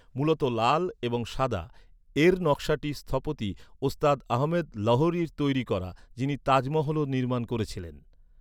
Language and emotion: Bengali, neutral